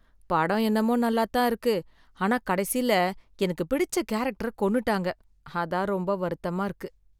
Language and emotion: Tamil, sad